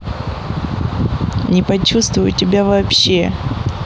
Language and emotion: Russian, neutral